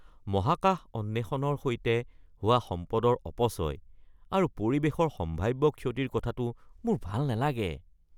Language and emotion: Assamese, disgusted